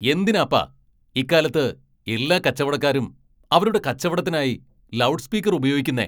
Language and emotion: Malayalam, angry